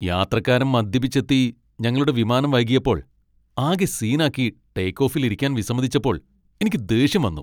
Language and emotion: Malayalam, angry